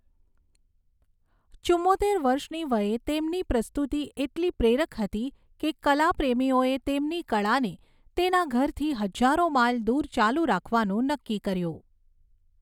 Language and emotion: Gujarati, neutral